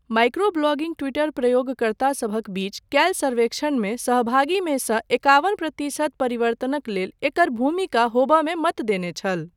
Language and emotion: Maithili, neutral